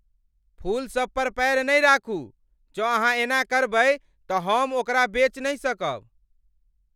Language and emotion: Maithili, angry